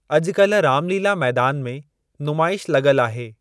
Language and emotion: Sindhi, neutral